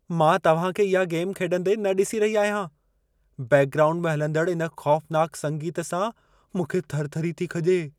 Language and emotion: Sindhi, fearful